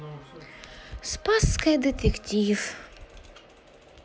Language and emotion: Russian, sad